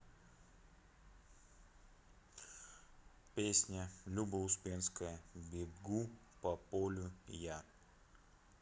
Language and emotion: Russian, neutral